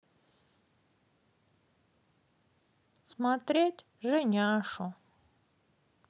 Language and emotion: Russian, sad